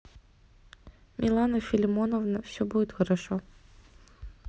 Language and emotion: Russian, neutral